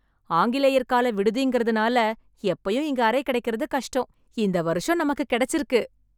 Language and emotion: Tamil, happy